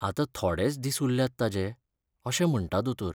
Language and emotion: Goan Konkani, sad